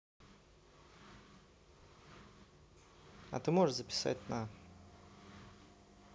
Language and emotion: Russian, neutral